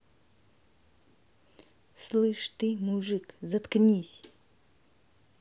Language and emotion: Russian, angry